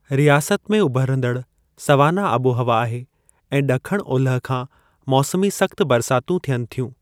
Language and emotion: Sindhi, neutral